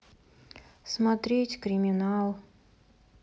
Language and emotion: Russian, sad